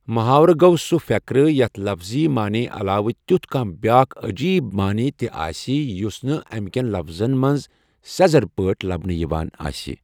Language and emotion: Kashmiri, neutral